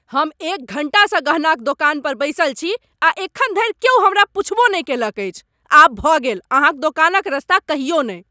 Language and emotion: Maithili, angry